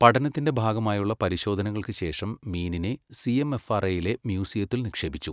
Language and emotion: Malayalam, neutral